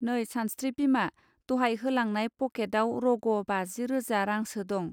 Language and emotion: Bodo, neutral